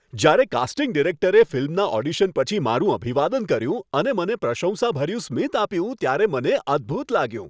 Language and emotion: Gujarati, happy